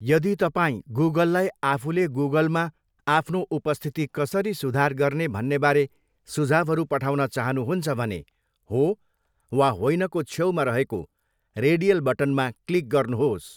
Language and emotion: Nepali, neutral